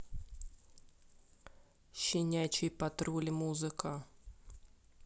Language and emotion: Russian, neutral